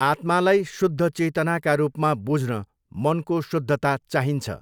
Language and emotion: Nepali, neutral